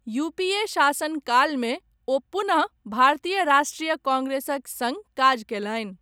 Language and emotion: Maithili, neutral